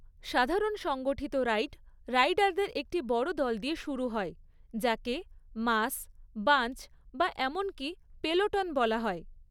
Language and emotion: Bengali, neutral